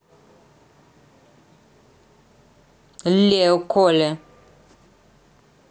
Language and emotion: Russian, angry